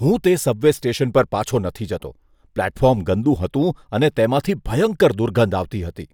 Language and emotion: Gujarati, disgusted